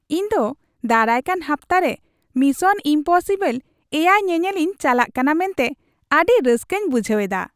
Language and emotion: Santali, happy